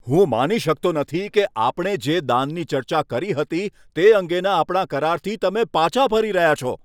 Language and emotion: Gujarati, angry